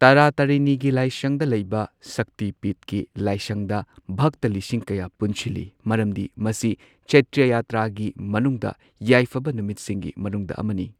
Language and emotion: Manipuri, neutral